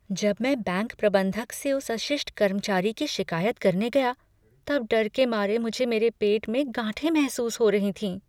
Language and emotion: Hindi, fearful